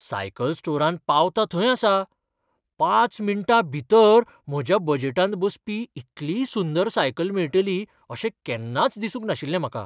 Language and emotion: Goan Konkani, surprised